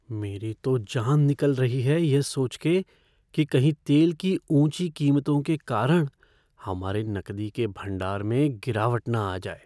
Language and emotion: Hindi, fearful